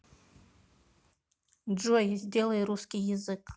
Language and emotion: Russian, neutral